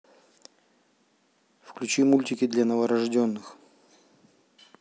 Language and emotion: Russian, neutral